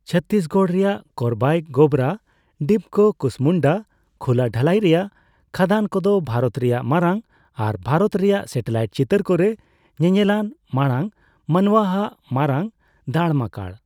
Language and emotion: Santali, neutral